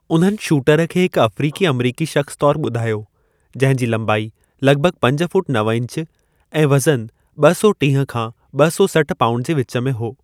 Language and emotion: Sindhi, neutral